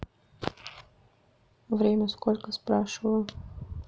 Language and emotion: Russian, neutral